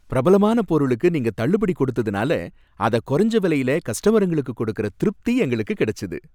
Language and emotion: Tamil, happy